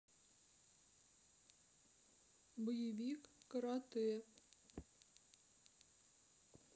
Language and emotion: Russian, sad